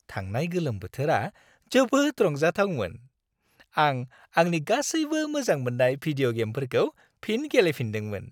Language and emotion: Bodo, happy